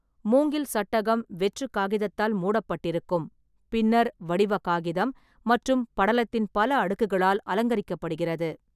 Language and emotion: Tamil, neutral